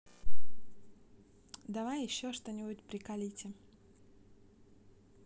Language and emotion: Russian, neutral